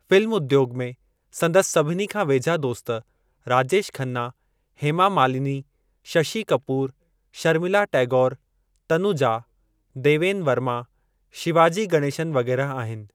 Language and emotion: Sindhi, neutral